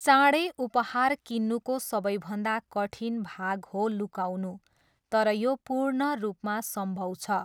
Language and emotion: Nepali, neutral